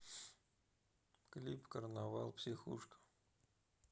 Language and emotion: Russian, sad